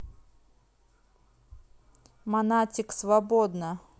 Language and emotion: Russian, neutral